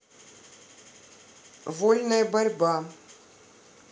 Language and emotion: Russian, neutral